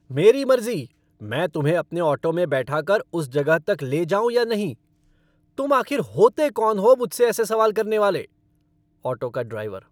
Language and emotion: Hindi, angry